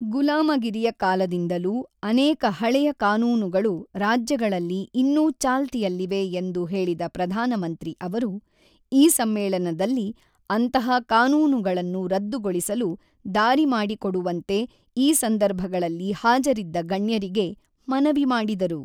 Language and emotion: Kannada, neutral